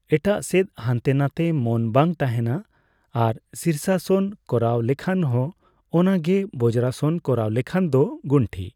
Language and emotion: Santali, neutral